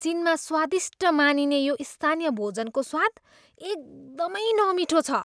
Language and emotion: Nepali, disgusted